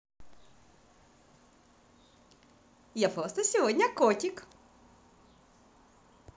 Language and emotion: Russian, positive